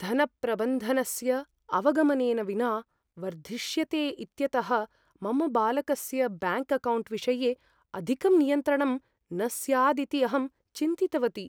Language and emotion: Sanskrit, fearful